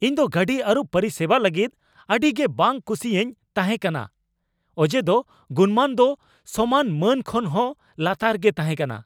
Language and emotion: Santali, angry